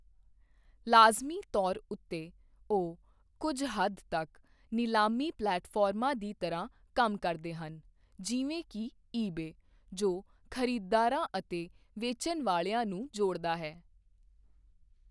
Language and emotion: Punjabi, neutral